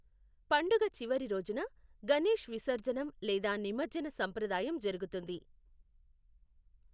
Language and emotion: Telugu, neutral